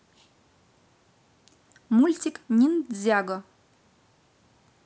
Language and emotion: Russian, positive